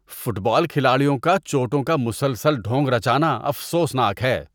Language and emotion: Urdu, disgusted